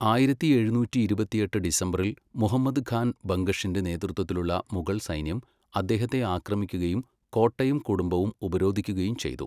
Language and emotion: Malayalam, neutral